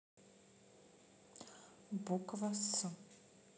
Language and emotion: Russian, neutral